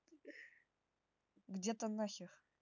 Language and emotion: Russian, neutral